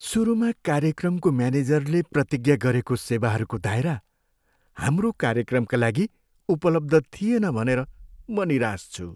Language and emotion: Nepali, sad